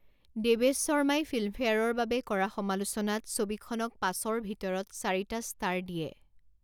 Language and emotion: Assamese, neutral